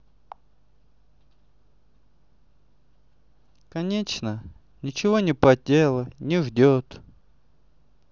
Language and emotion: Russian, sad